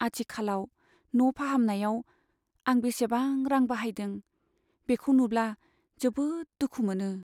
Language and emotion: Bodo, sad